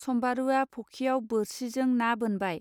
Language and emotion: Bodo, neutral